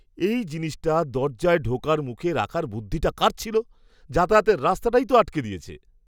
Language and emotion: Bengali, disgusted